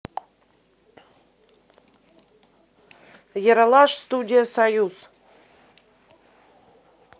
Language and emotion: Russian, neutral